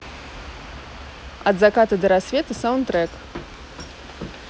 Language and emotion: Russian, neutral